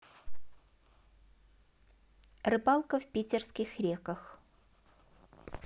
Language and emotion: Russian, neutral